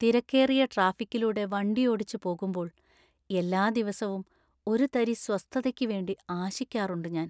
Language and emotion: Malayalam, sad